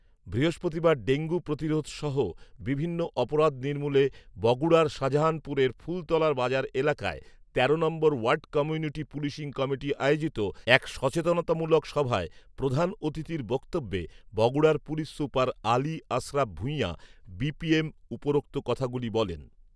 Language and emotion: Bengali, neutral